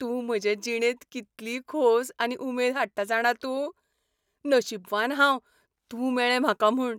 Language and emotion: Goan Konkani, happy